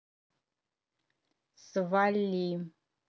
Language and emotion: Russian, angry